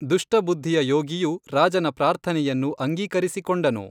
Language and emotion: Kannada, neutral